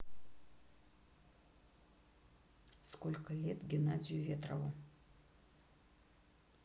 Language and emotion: Russian, neutral